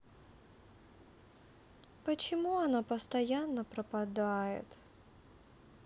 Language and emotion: Russian, sad